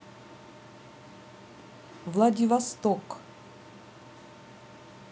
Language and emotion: Russian, neutral